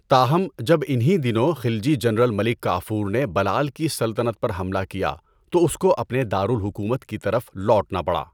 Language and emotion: Urdu, neutral